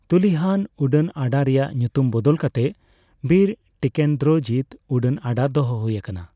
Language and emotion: Santali, neutral